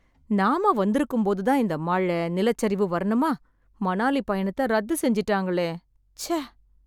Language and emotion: Tamil, sad